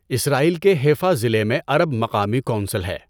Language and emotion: Urdu, neutral